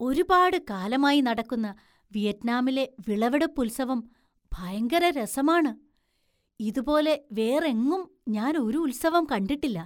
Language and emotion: Malayalam, surprised